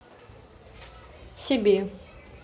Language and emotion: Russian, neutral